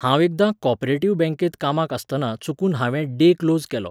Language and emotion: Goan Konkani, neutral